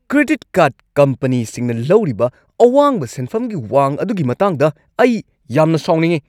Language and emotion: Manipuri, angry